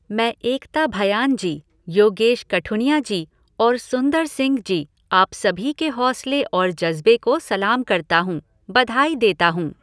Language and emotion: Hindi, neutral